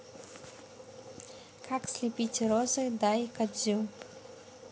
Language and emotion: Russian, neutral